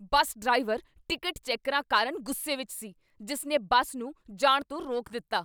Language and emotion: Punjabi, angry